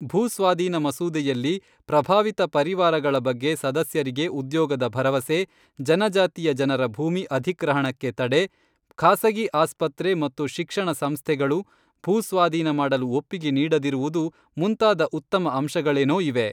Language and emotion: Kannada, neutral